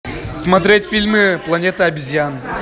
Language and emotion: Russian, positive